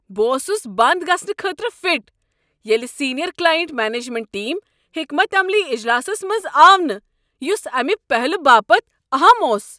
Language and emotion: Kashmiri, angry